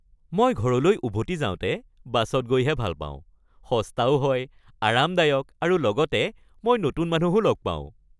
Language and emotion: Assamese, happy